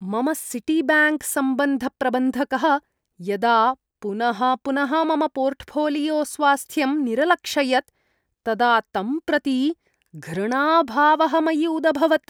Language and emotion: Sanskrit, disgusted